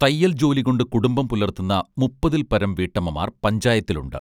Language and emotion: Malayalam, neutral